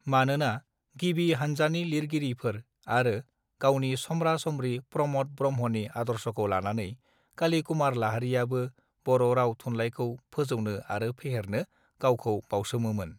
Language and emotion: Bodo, neutral